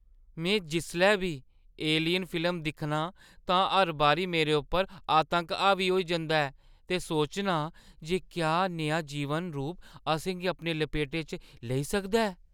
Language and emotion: Dogri, fearful